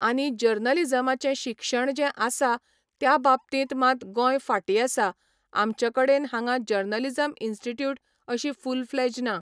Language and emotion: Goan Konkani, neutral